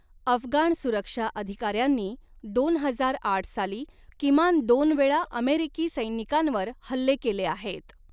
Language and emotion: Marathi, neutral